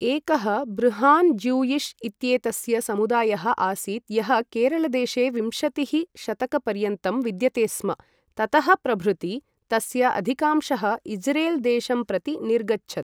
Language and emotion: Sanskrit, neutral